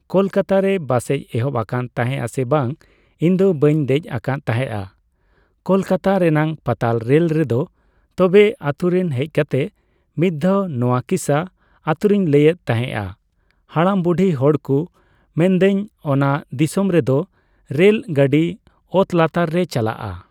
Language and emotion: Santali, neutral